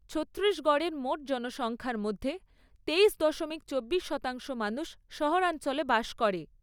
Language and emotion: Bengali, neutral